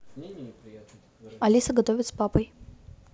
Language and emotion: Russian, neutral